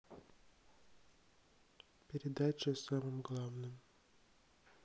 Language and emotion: Russian, sad